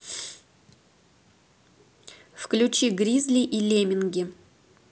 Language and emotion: Russian, neutral